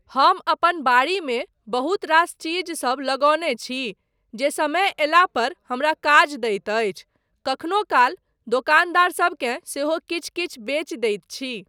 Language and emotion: Maithili, neutral